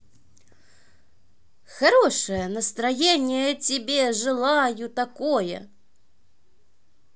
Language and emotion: Russian, positive